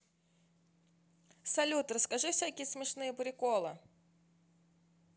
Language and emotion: Russian, positive